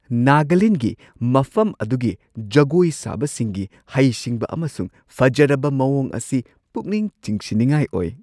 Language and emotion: Manipuri, surprised